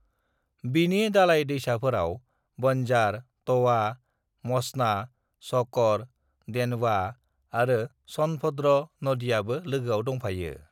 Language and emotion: Bodo, neutral